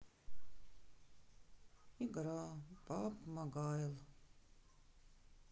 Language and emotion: Russian, sad